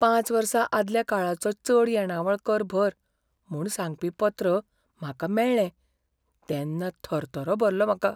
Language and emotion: Goan Konkani, fearful